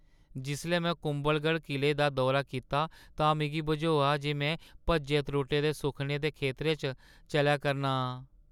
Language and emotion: Dogri, sad